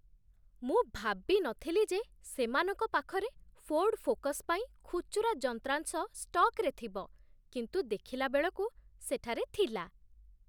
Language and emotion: Odia, surprised